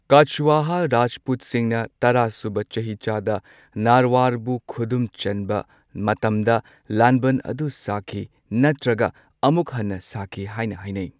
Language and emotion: Manipuri, neutral